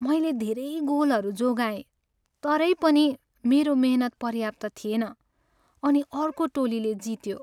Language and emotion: Nepali, sad